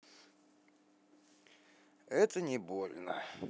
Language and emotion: Russian, neutral